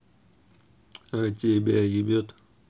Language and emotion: Russian, neutral